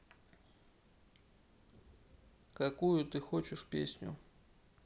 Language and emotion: Russian, neutral